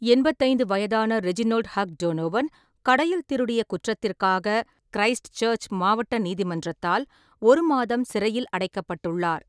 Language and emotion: Tamil, neutral